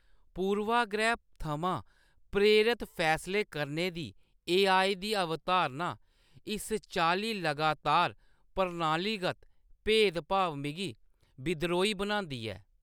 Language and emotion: Dogri, disgusted